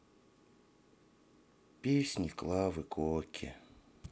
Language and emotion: Russian, sad